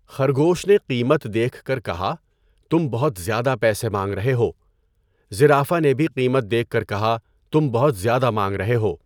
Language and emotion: Urdu, neutral